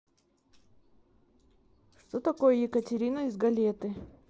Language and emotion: Russian, neutral